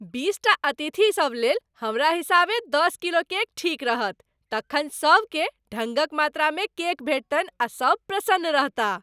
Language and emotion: Maithili, happy